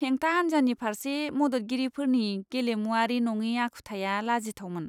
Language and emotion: Bodo, disgusted